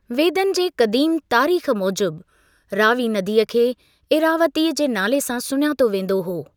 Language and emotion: Sindhi, neutral